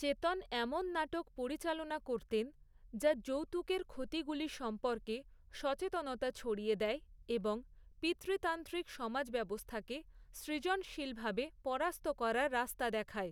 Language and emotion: Bengali, neutral